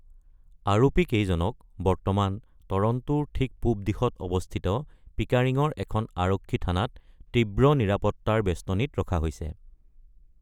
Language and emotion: Assamese, neutral